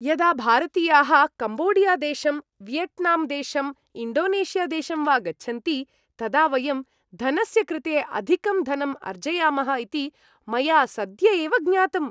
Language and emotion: Sanskrit, happy